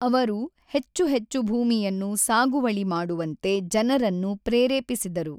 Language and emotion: Kannada, neutral